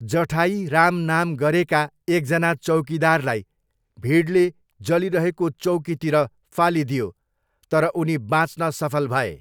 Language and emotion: Nepali, neutral